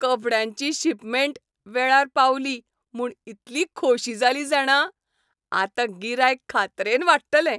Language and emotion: Goan Konkani, happy